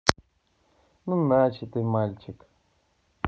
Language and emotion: Russian, neutral